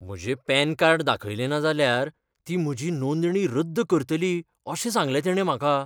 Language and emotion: Goan Konkani, fearful